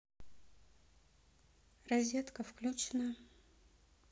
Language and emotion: Russian, neutral